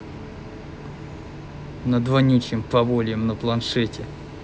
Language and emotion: Russian, angry